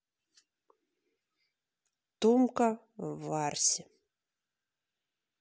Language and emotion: Russian, neutral